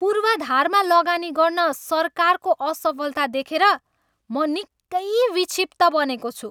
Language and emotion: Nepali, angry